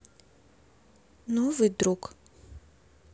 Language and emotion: Russian, neutral